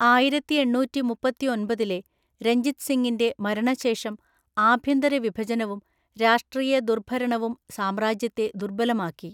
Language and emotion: Malayalam, neutral